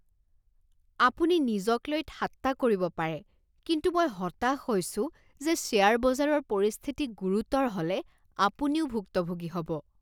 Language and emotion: Assamese, disgusted